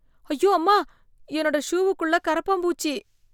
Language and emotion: Tamil, fearful